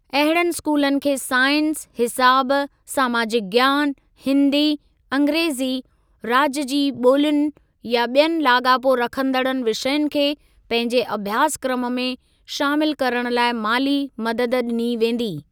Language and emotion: Sindhi, neutral